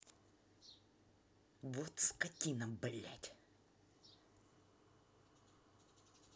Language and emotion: Russian, angry